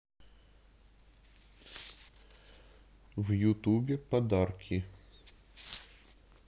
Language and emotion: Russian, neutral